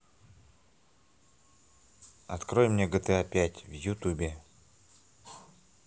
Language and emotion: Russian, neutral